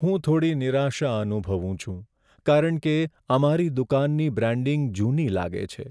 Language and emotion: Gujarati, sad